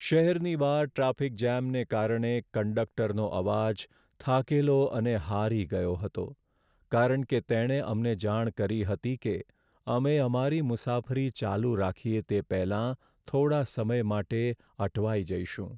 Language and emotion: Gujarati, sad